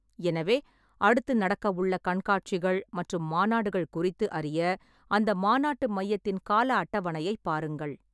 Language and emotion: Tamil, neutral